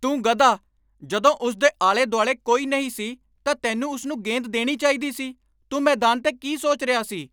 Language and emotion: Punjabi, angry